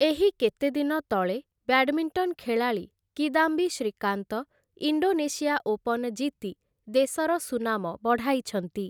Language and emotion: Odia, neutral